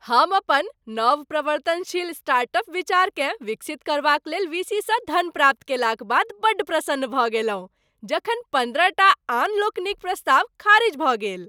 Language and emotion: Maithili, happy